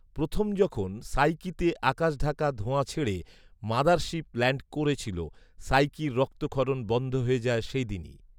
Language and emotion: Bengali, neutral